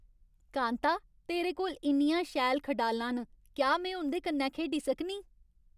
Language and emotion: Dogri, happy